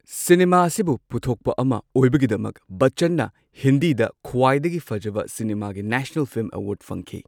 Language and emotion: Manipuri, neutral